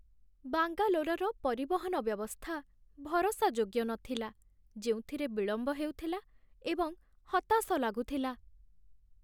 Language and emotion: Odia, sad